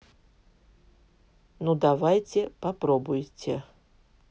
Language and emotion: Russian, neutral